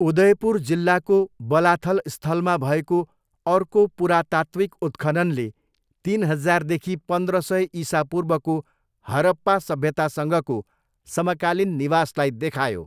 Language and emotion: Nepali, neutral